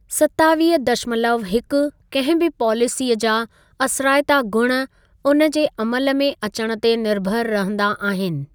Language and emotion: Sindhi, neutral